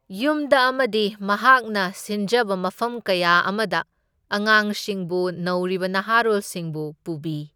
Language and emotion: Manipuri, neutral